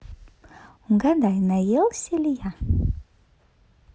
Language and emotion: Russian, positive